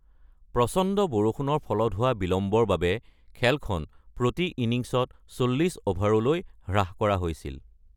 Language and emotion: Assamese, neutral